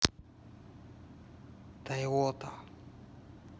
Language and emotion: Russian, neutral